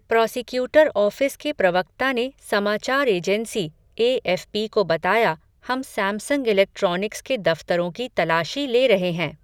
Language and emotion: Hindi, neutral